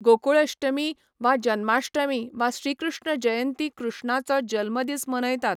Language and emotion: Goan Konkani, neutral